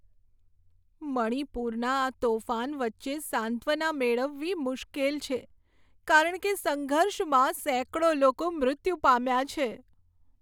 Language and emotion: Gujarati, sad